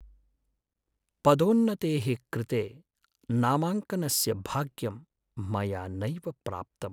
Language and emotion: Sanskrit, sad